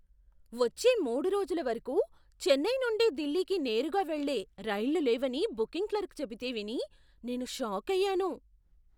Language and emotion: Telugu, surprised